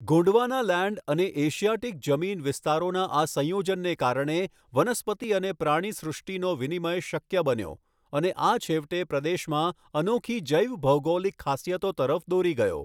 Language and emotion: Gujarati, neutral